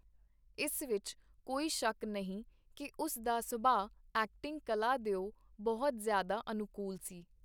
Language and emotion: Punjabi, neutral